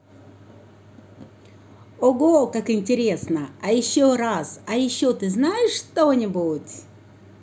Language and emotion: Russian, positive